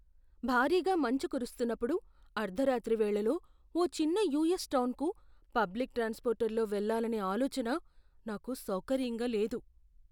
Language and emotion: Telugu, fearful